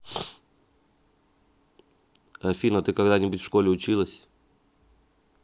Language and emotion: Russian, neutral